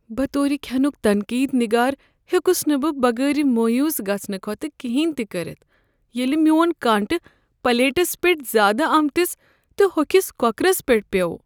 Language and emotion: Kashmiri, sad